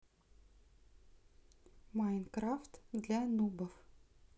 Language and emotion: Russian, neutral